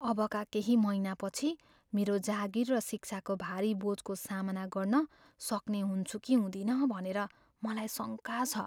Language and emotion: Nepali, fearful